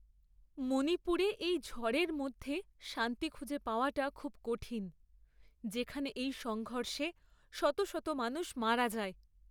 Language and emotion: Bengali, sad